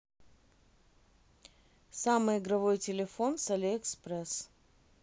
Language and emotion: Russian, neutral